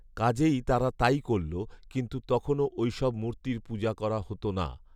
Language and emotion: Bengali, neutral